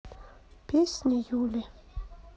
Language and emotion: Russian, sad